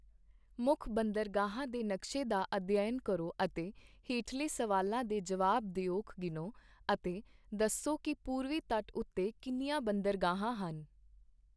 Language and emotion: Punjabi, neutral